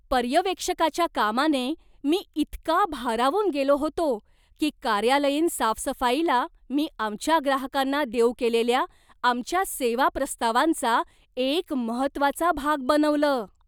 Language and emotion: Marathi, surprised